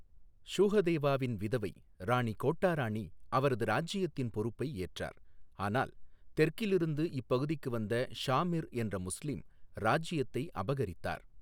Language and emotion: Tamil, neutral